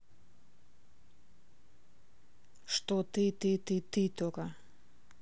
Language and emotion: Russian, neutral